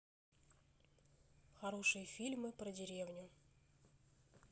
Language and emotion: Russian, neutral